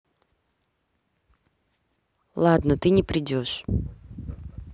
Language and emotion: Russian, neutral